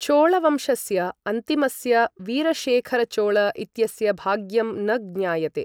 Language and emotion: Sanskrit, neutral